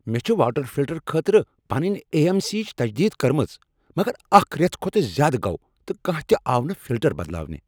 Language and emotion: Kashmiri, angry